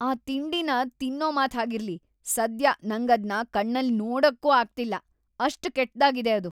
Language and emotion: Kannada, disgusted